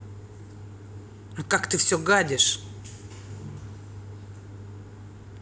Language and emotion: Russian, angry